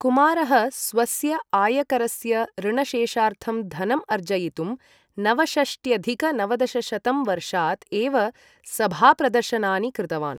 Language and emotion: Sanskrit, neutral